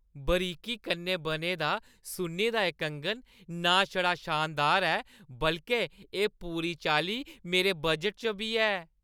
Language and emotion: Dogri, happy